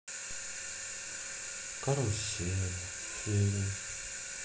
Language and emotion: Russian, sad